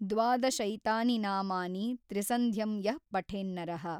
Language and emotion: Kannada, neutral